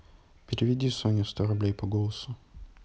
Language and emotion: Russian, neutral